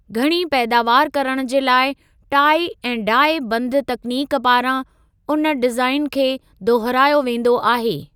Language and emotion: Sindhi, neutral